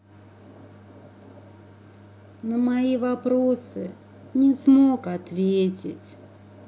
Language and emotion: Russian, sad